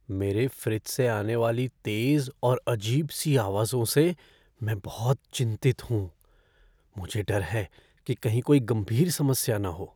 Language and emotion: Hindi, fearful